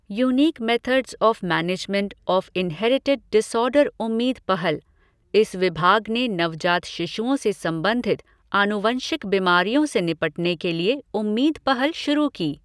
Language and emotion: Hindi, neutral